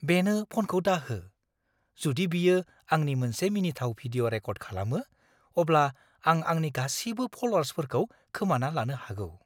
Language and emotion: Bodo, fearful